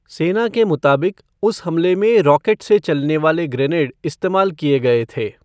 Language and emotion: Hindi, neutral